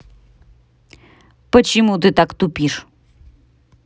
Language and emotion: Russian, angry